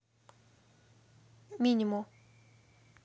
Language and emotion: Russian, neutral